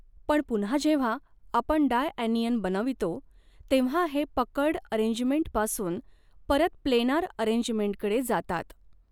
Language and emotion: Marathi, neutral